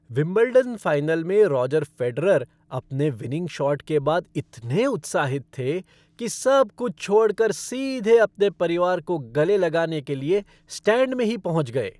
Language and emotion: Hindi, happy